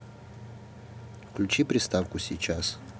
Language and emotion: Russian, neutral